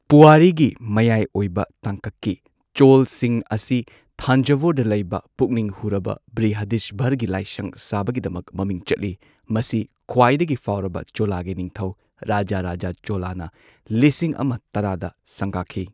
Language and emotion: Manipuri, neutral